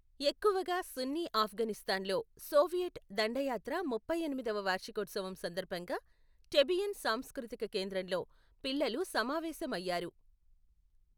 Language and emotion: Telugu, neutral